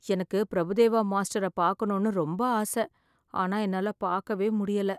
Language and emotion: Tamil, sad